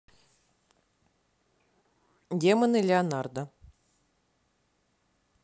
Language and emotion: Russian, neutral